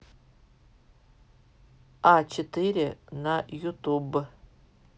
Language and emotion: Russian, neutral